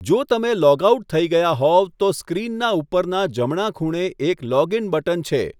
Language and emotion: Gujarati, neutral